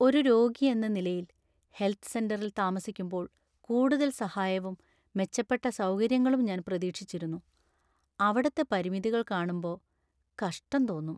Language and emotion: Malayalam, sad